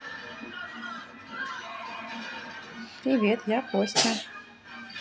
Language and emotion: Russian, positive